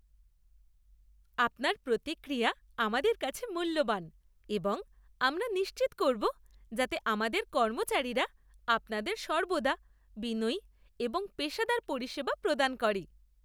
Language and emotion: Bengali, happy